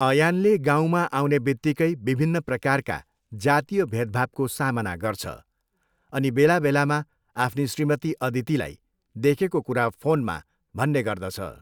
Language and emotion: Nepali, neutral